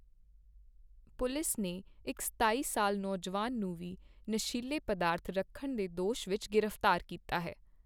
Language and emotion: Punjabi, neutral